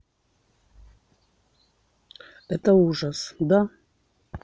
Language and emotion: Russian, neutral